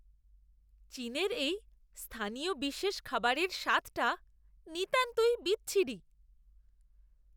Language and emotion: Bengali, disgusted